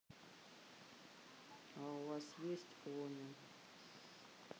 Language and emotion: Russian, neutral